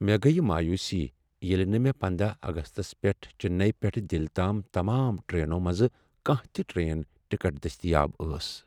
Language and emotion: Kashmiri, sad